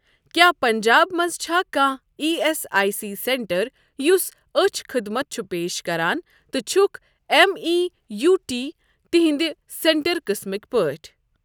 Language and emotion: Kashmiri, neutral